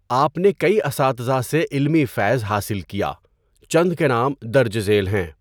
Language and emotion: Urdu, neutral